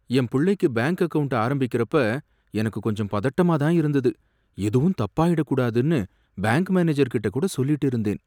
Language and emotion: Tamil, fearful